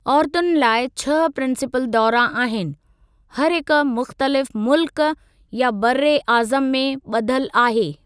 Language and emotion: Sindhi, neutral